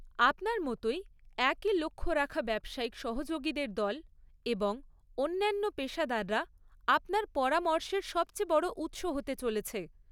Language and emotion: Bengali, neutral